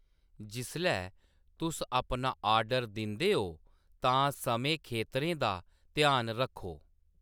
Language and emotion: Dogri, neutral